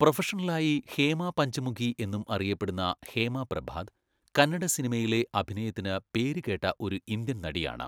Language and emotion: Malayalam, neutral